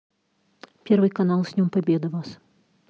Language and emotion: Russian, neutral